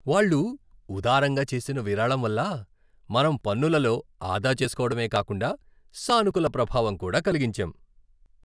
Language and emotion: Telugu, happy